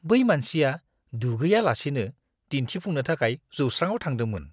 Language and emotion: Bodo, disgusted